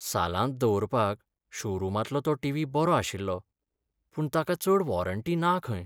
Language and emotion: Goan Konkani, sad